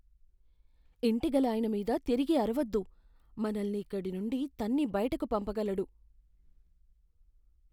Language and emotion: Telugu, fearful